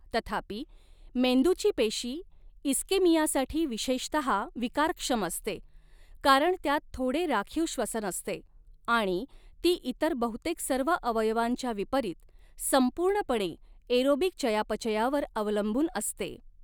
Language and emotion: Marathi, neutral